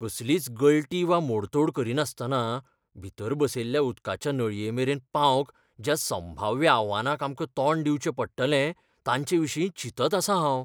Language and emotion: Goan Konkani, fearful